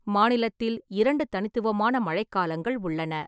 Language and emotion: Tamil, neutral